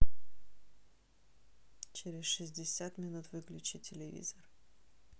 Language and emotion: Russian, neutral